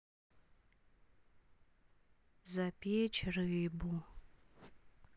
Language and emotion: Russian, sad